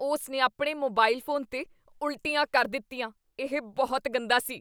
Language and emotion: Punjabi, disgusted